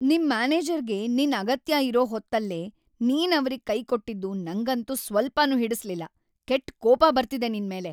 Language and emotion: Kannada, angry